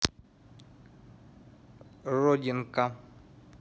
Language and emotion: Russian, neutral